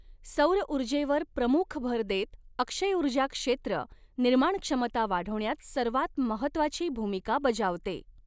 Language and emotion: Marathi, neutral